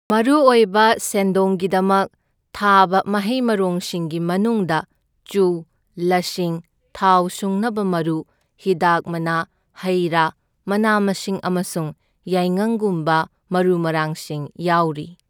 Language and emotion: Manipuri, neutral